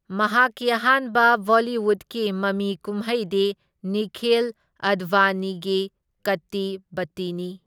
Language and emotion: Manipuri, neutral